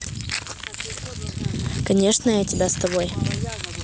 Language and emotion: Russian, neutral